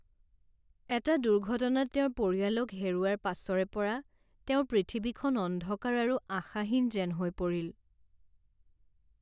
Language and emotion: Assamese, sad